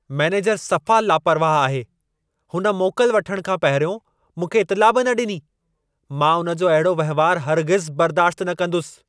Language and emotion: Sindhi, angry